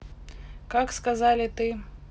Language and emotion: Russian, neutral